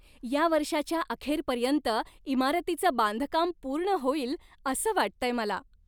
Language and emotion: Marathi, happy